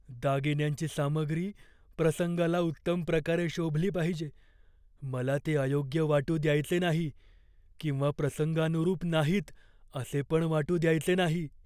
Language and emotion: Marathi, fearful